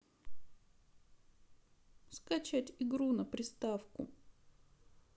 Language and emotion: Russian, sad